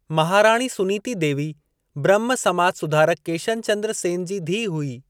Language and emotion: Sindhi, neutral